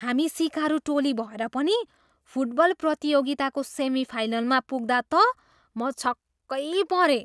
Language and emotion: Nepali, surprised